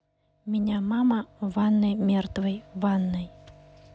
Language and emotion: Russian, neutral